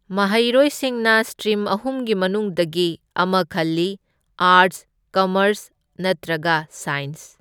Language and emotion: Manipuri, neutral